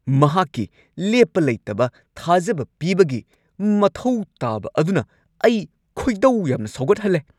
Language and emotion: Manipuri, angry